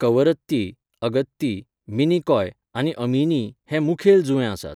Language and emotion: Goan Konkani, neutral